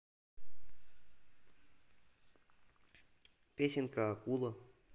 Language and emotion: Russian, neutral